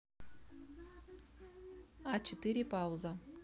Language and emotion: Russian, neutral